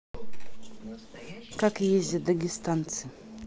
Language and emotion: Russian, neutral